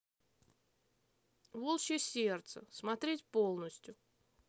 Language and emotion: Russian, neutral